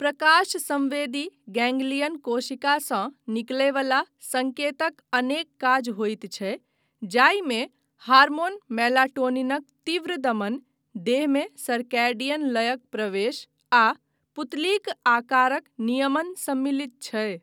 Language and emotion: Maithili, neutral